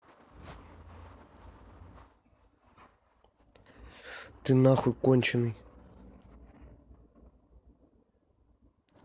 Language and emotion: Russian, angry